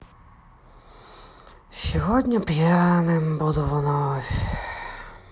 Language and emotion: Russian, sad